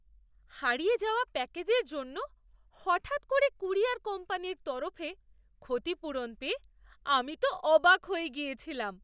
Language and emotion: Bengali, surprised